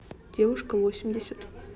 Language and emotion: Russian, neutral